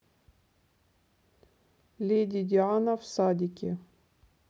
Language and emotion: Russian, neutral